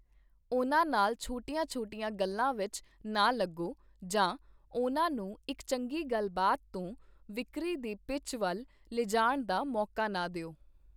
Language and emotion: Punjabi, neutral